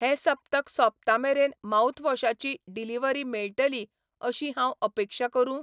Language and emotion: Goan Konkani, neutral